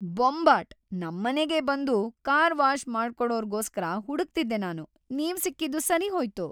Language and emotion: Kannada, happy